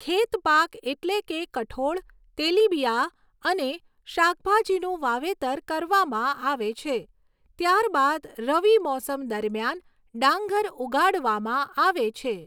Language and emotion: Gujarati, neutral